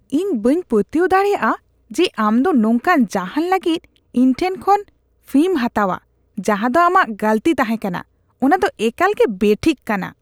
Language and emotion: Santali, disgusted